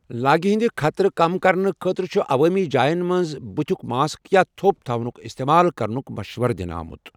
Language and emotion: Kashmiri, neutral